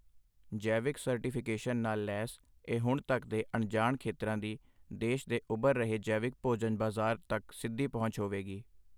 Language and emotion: Punjabi, neutral